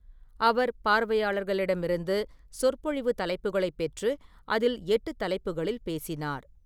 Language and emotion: Tamil, neutral